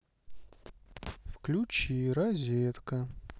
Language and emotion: Russian, neutral